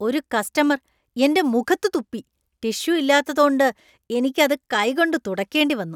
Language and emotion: Malayalam, disgusted